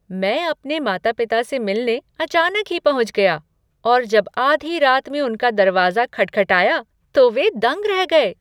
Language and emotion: Hindi, surprised